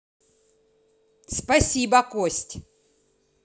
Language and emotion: Russian, angry